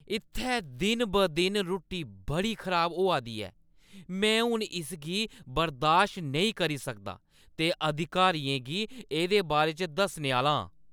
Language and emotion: Dogri, angry